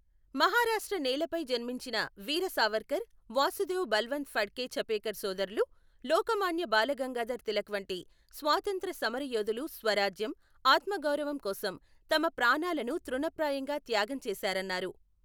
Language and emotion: Telugu, neutral